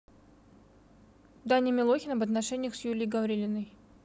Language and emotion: Russian, neutral